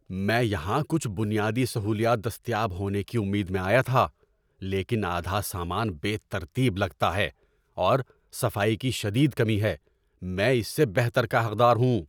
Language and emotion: Urdu, angry